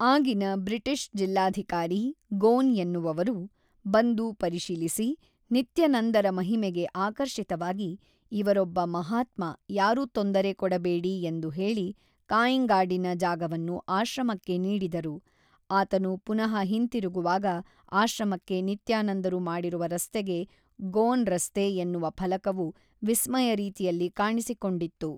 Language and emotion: Kannada, neutral